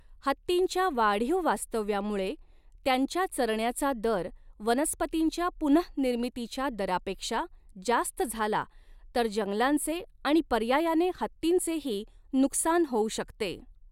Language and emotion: Marathi, neutral